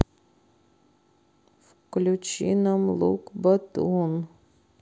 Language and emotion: Russian, sad